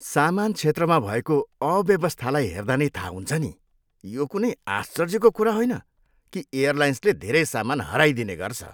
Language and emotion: Nepali, disgusted